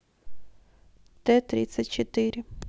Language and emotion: Russian, neutral